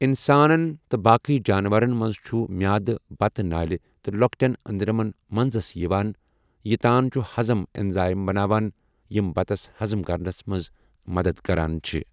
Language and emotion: Kashmiri, neutral